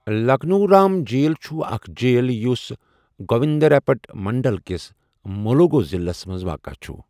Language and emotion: Kashmiri, neutral